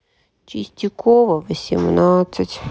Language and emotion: Russian, sad